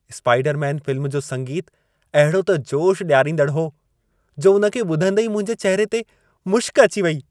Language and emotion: Sindhi, happy